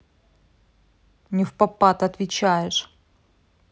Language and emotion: Russian, angry